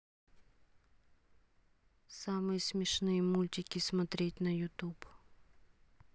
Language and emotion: Russian, neutral